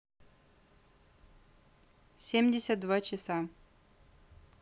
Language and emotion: Russian, neutral